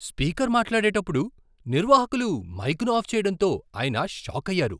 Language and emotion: Telugu, surprised